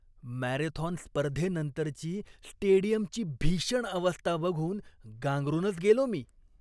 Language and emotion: Marathi, disgusted